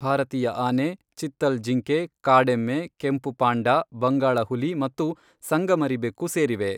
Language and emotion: Kannada, neutral